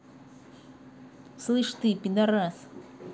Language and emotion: Russian, angry